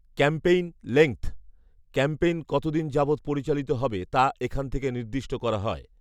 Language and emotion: Bengali, neutral